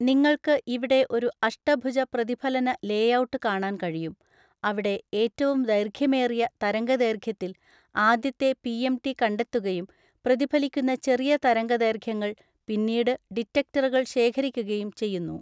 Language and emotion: Malayalam, neutral